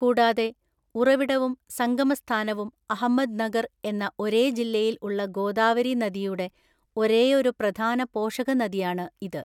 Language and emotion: Malayalam, neutral